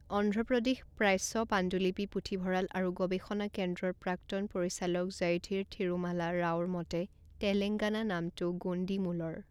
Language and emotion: Assamese, neutral